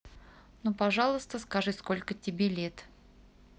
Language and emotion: Russian, neutral